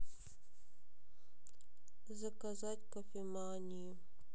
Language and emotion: Russian, sad